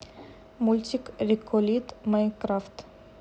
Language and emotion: Russian, neutral